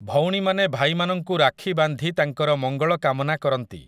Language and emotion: Odia, neutral